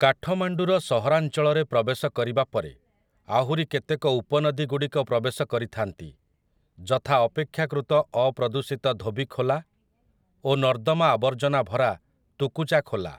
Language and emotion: Odia, neutral